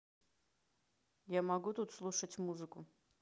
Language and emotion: Russian, neutral